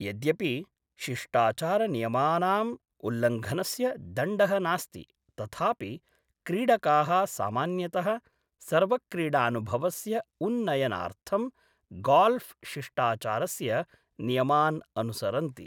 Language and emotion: Sanskrit, neutral